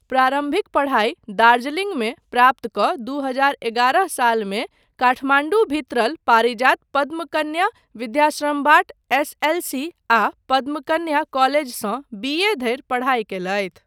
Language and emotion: Maithili, neutral